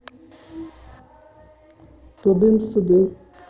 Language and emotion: Russian, neutral